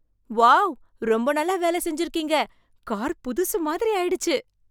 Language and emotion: Tamil, surprised